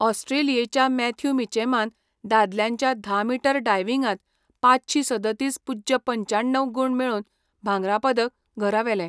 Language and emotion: Goan Konkani, neutral